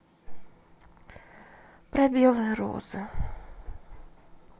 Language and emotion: Russian, sad